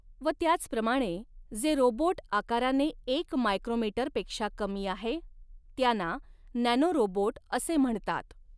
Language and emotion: Marathi, neutral